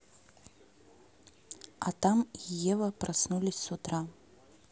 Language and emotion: Russian, neutral